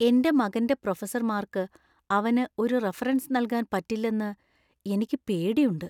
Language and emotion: Malayalam, fearful